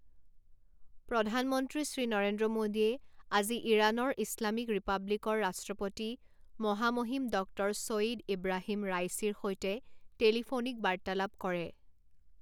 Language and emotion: Assamese, neutral